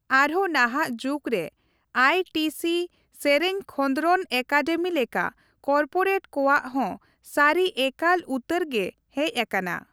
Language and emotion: Santali, neutral